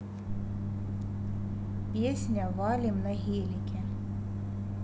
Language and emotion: Russian, neutral